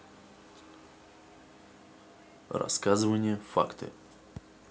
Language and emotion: Russian, neutral